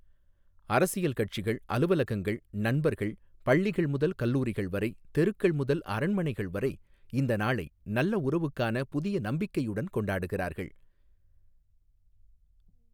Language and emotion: Tamil, neutral